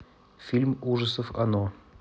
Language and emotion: Russian, neutral